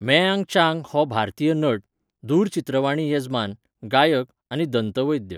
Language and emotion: Goan Konkani, neutral